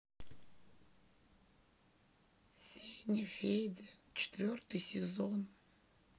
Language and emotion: Russian, sad